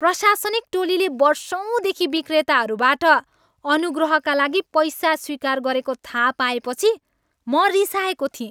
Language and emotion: Nepali, angry